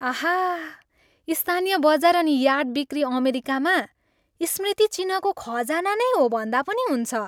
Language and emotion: Nepali, happy